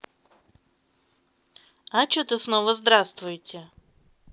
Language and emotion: Russian, neutral